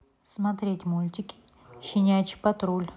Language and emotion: Russian, neutral